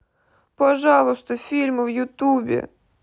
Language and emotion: Russian, sad